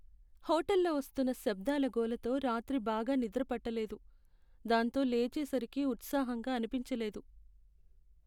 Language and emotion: Telugu, sad